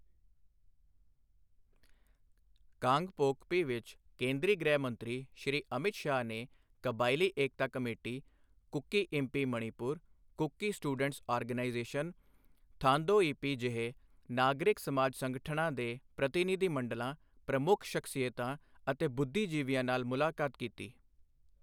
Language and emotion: Punjabi, neutral